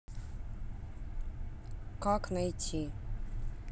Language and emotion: Russian, neutral